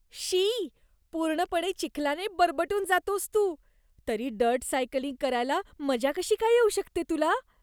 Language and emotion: Marathi, disgusted